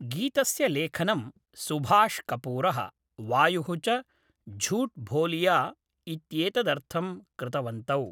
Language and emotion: Sanskrit, neutral